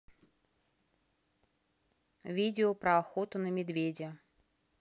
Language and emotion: Russian, neutral